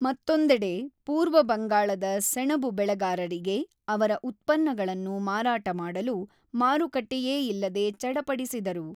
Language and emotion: Kannada, neutral